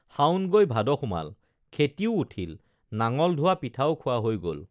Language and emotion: Assamese, neutral